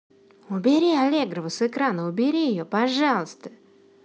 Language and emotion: Russian, angry